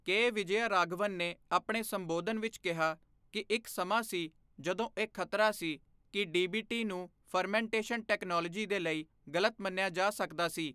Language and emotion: Punjabi, neutral